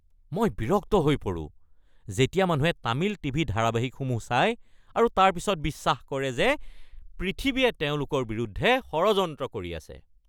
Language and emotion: Assamese, angry